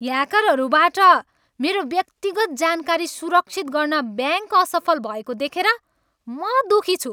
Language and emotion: Nepali, angry